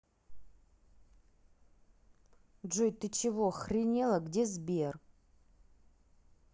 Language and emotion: Russian, angry